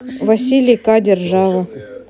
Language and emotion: Russian, neutral